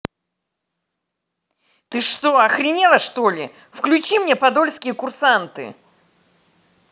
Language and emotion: Russian, angry